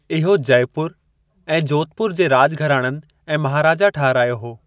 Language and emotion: Sindhi, neutral